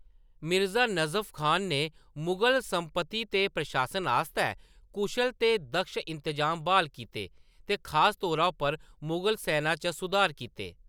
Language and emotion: Dogri, neutral